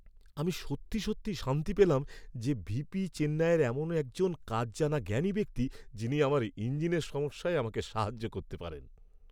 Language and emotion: Bengali, happy